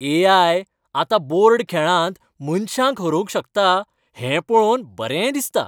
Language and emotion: Goan Konkani, happy